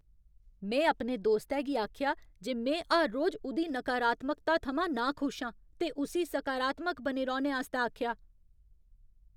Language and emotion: Dogri, angry